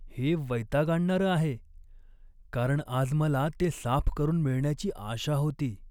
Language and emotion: Marathi, sad